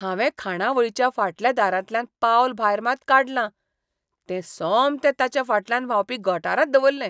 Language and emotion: Goan Konkani, disgusted